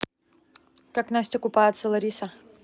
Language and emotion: Russian, neutral